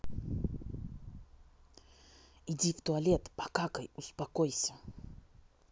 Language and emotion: Russian, angry